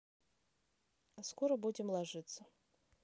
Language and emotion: Russian, neutral